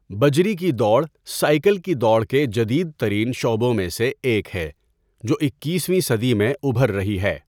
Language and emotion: Urdu, neutral